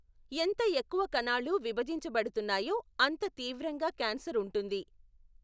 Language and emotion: Telugu, neutral